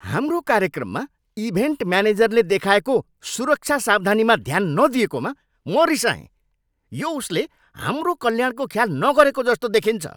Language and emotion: Nepali, angry